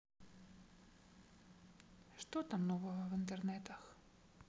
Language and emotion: Russian, sad